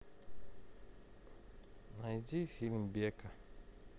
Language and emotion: Russian, neutral